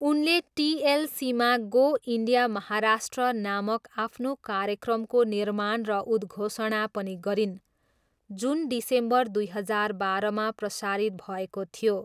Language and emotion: Nepali, neutral